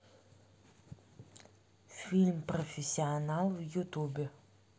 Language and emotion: Russian, neutral